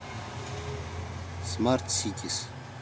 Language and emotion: Russian, neutral